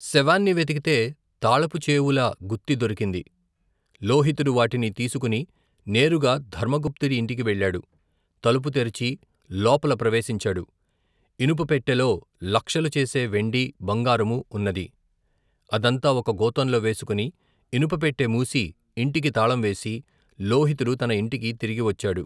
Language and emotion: Telugu, neutral